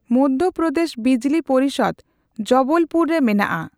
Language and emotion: Santali, neutral